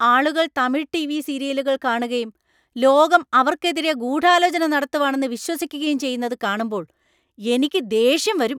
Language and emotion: Malayalam, angry